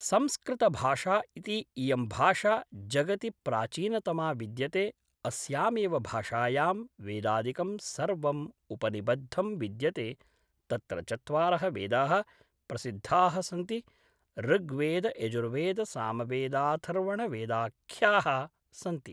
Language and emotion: Sanskrit, neutral